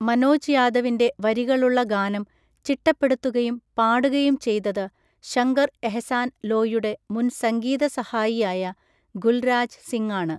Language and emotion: Malayalam, neutral